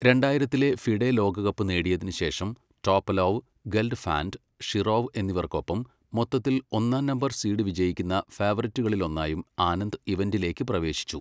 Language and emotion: Malayalam, neutral